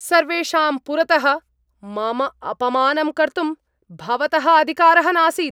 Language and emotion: Sanskrit, angry